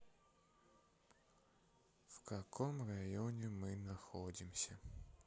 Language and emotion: Russian, sad